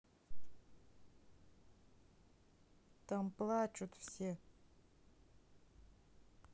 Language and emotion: Russian, neutral